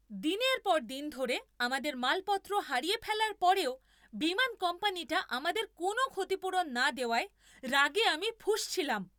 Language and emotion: Bengali, angry